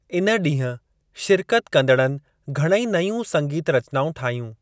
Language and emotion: Sindhi, neutral